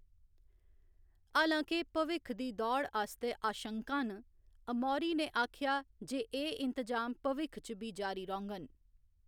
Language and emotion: Dogri, neutral